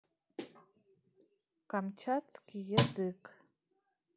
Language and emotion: Russian, neutral